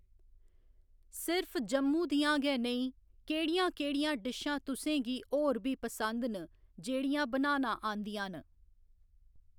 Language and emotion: Dogri, neutral